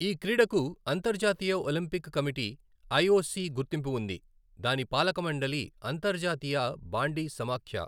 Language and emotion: Telugu, neutral